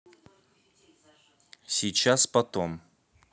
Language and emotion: Russian, neutral